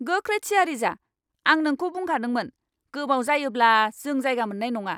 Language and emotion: Bodo, angry